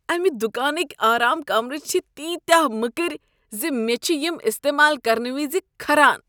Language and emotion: Kashmiri, disgusted